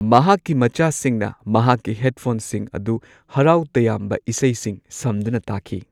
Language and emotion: Manipuri, neutral